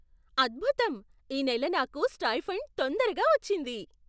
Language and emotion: Telugu, surprised